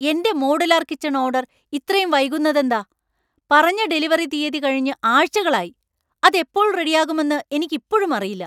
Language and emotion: Malayalam, angry